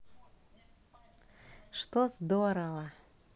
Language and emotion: Russian, positive